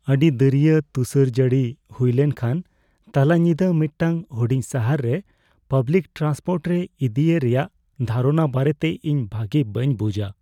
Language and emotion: Santali, fearful